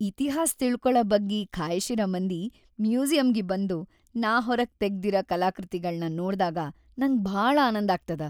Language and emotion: Kannada, happy